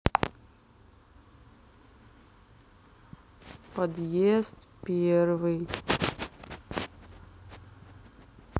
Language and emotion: Russian, sad